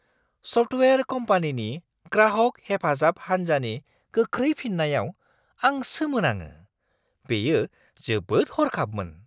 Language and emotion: Bodo, surprised